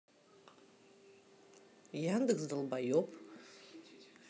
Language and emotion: Russian, neutral